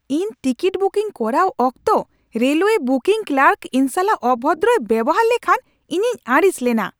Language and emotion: Santali, angry